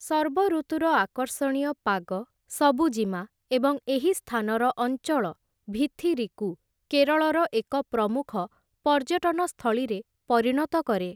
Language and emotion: Odia, neutral